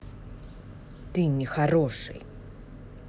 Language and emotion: Russian, angry